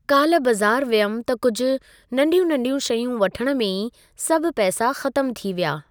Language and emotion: Sindhi, neutral